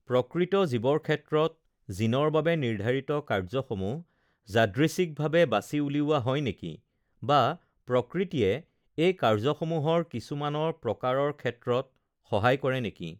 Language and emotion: Assamese, neutral